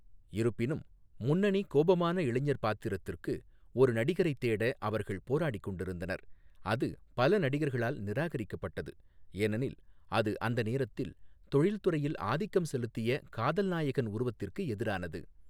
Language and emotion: Tamil, neutral